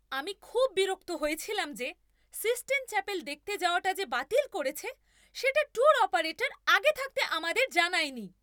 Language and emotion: Bengali, angry